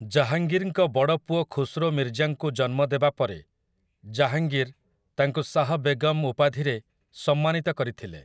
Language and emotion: Odia, neutral